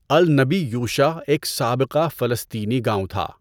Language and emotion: Urdu, neutral